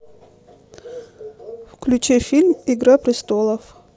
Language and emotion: Russian, neutral